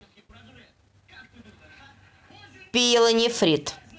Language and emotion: Russian, neutral